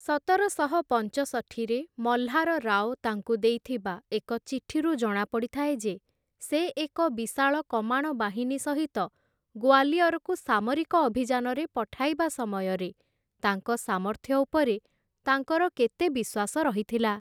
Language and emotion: Odia, neutral